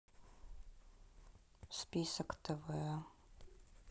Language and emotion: Russian, sad